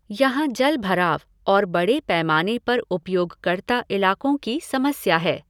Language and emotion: Hindi, neutral